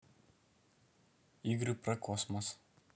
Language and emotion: Russian, neutral